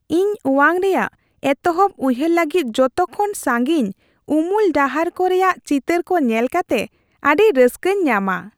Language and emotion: Santali, happy